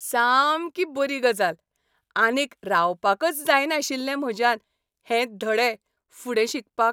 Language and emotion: Goan Konkani, happy